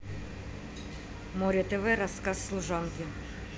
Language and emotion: Russian, neutral